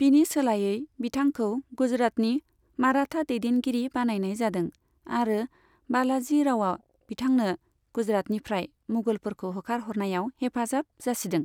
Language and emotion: Bodo, neutral